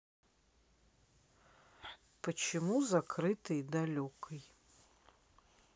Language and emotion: Russian, neutral